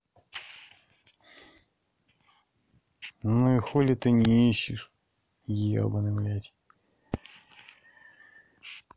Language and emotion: Russian, angry